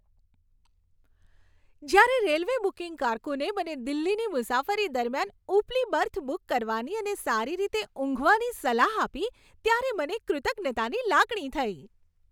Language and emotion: Gujarati, happy